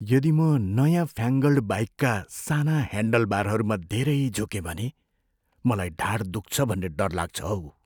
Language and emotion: Nepali, fearful